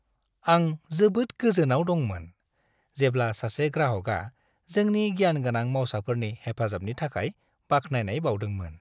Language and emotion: Bodo, happy